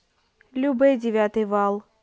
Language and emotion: Russian, neutral